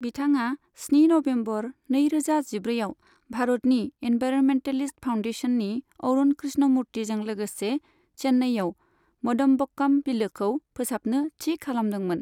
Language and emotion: Bodo, neutral